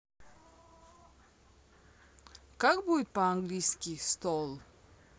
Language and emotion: Russian, neutral